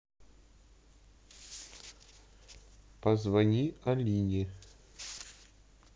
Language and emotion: Russian, neutral